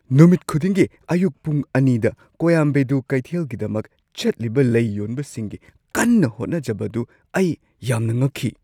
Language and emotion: Manipuri, surprised